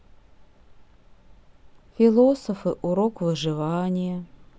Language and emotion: Russian, sad